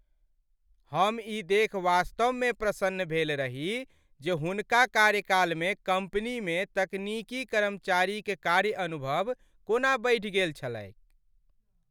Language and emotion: Maithili, happy